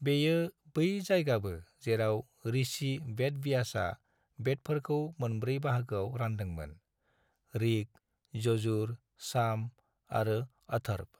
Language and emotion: Bodo, neutral